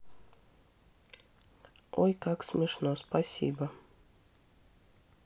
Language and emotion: Russian, neutral